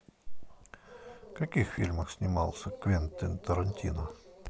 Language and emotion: Russian, neutral